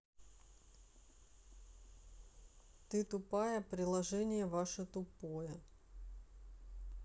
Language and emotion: Russian, neutral